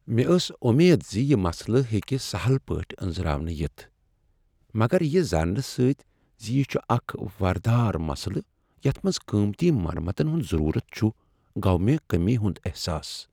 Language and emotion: Kashmiri, sad